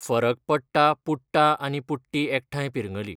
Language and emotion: Goan Konkani, neutral